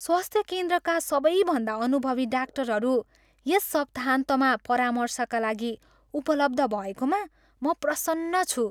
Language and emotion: Nepali, happy